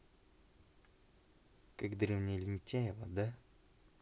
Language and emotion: Russian, neutral